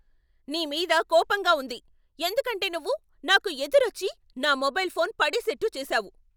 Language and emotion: Telugu, angry